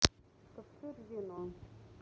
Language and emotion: Russian, neutral